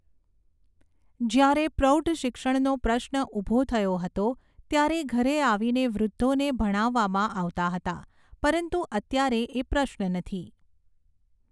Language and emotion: Gujarati, neutral